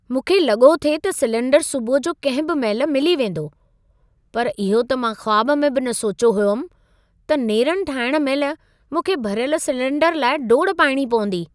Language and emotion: Sindhi, surprised